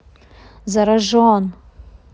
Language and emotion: Russian, angry